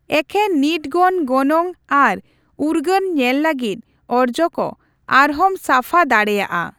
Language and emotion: Santali, neutral